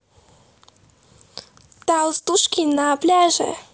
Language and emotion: Russian, positive